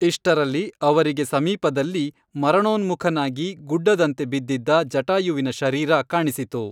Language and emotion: Kannada, neutral